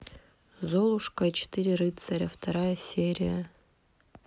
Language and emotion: Russian, neutral